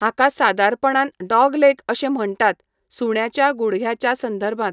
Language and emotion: Goan Konkani, neutral